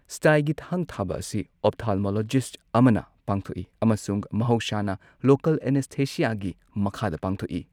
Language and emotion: Manipuri, neutral